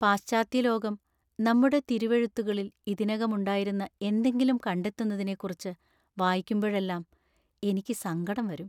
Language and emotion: Malayalam, sad